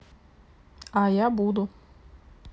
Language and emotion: Russian, neutral